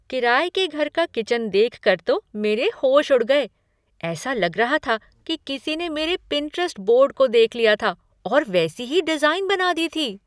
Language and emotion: Hindi, surprised